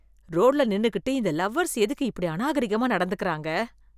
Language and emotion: Tamil, disgusted